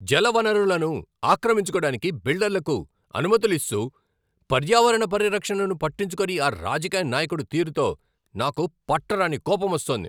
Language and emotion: Telugu, angry